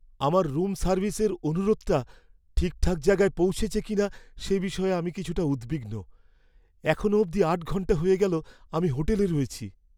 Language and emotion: Bengali, fearful